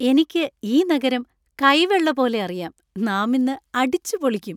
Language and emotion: Malayalam, happy